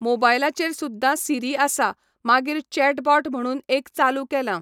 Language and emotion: Goan Konkani, neutral